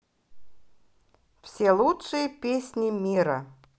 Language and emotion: Russian, positive